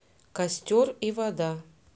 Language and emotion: Russian, neutral